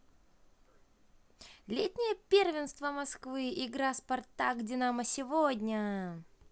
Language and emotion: Russian, positive